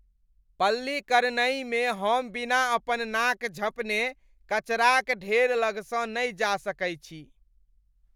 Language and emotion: Maithili, disgusted